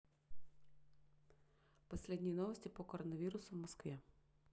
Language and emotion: Russian, neutral